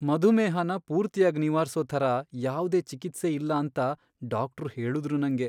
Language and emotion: Kannada, sad